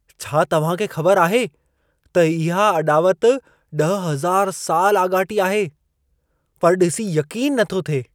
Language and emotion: Sindhi, surprised